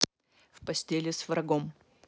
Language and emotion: Russian, neutral